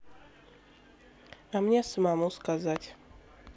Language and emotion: Russian, neutral